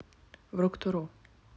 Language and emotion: Russian, neutral